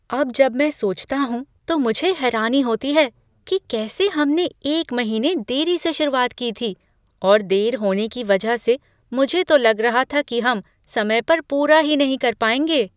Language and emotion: Hindi, surprised